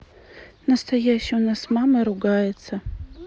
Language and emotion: Russian, neutral